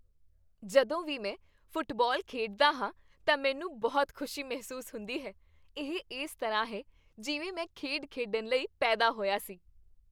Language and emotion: Punjabi, happy